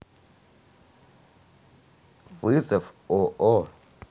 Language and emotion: Russian, neutral